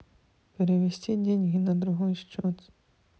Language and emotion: Russian, neutral